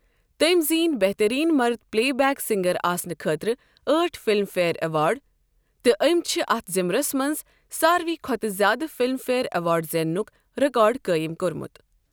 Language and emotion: Kashmiri, neutral